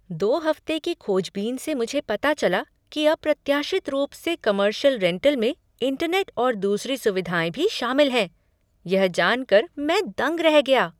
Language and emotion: Hindi, surprised